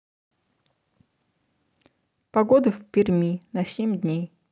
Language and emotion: Russian, neutral